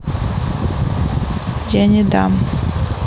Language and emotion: Russian, neutral